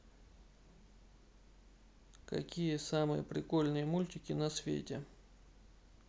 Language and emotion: Russian, neutral